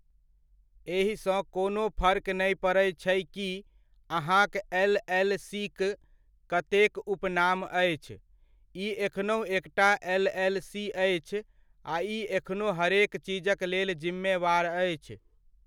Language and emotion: Maithili, neutral